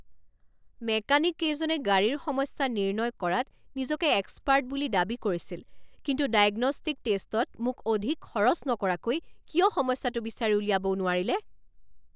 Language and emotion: Assamese, angry